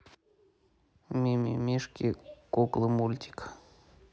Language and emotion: Russian, neutral